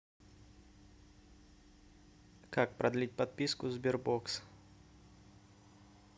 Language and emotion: Russian, neutral